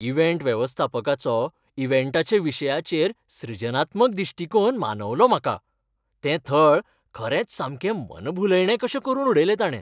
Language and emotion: Goan Konkani, happy